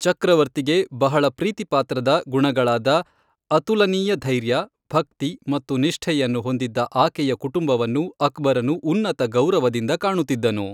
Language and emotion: Kannada, neutral